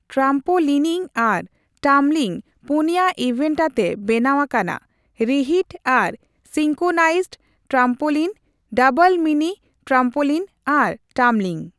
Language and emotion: Santali, neutral